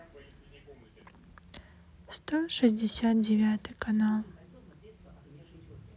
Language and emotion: Russian, sad